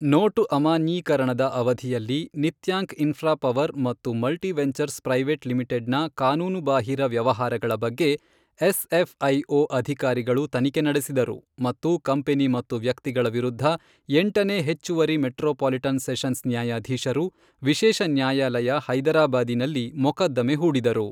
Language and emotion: Kannada, neutral